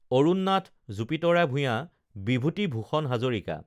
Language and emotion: Assamese, neutral